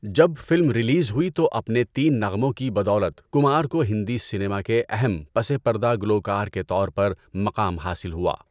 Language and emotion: Urdu, neutral